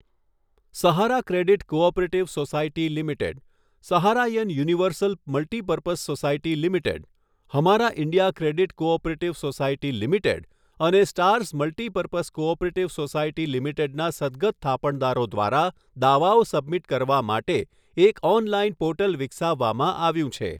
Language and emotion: Gujarati, neutral